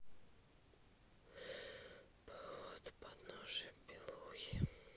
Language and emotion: Russian, sad